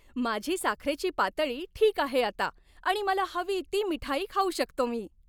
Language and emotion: Marathi, happy